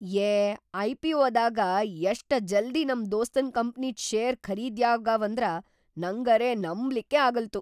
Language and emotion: Kannada, surprised